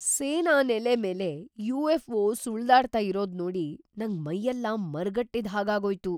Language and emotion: Kannada, surprised